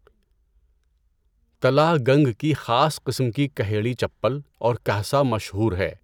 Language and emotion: Urdu, neutral